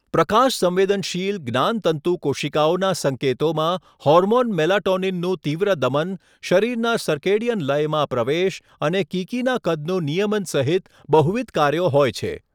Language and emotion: Gujarati, neutral